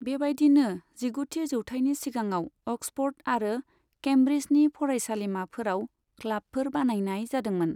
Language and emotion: Bodo, neutral